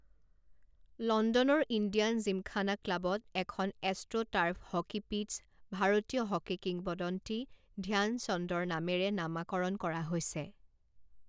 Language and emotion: Assamese, neutral